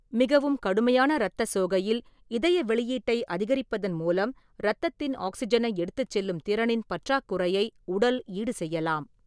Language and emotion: Tamil, neutral